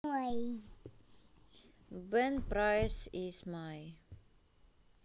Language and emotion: Russian, neutral